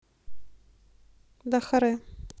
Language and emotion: Russian, neutral